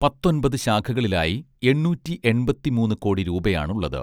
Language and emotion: Malayalam, neutral